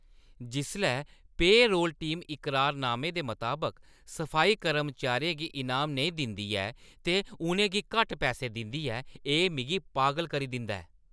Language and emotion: Dogri, angry